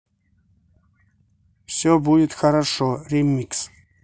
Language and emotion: Russian, neutral